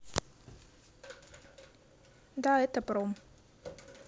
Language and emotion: Russian, neutral